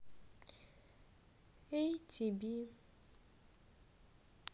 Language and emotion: Russian, sad